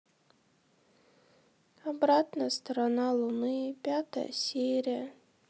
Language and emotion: Russian, sad